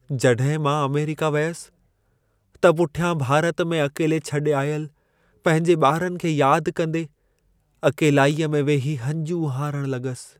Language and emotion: Sindhi, sad